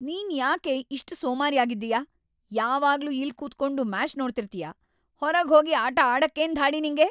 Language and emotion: Kannada, angry